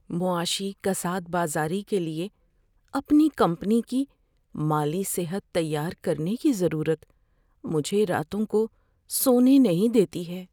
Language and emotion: Urdu, fearful